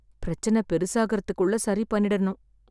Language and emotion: Tamil, sad